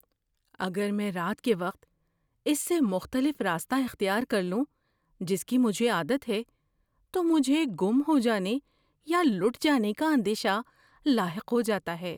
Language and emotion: Urdu, fearful